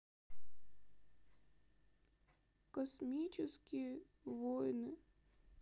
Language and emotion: Russian, sad